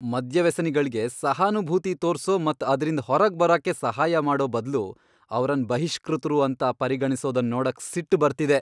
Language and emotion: Kannada, angry